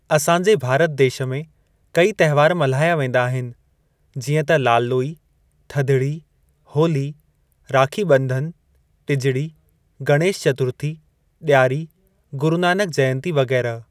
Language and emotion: Sindhi, neutral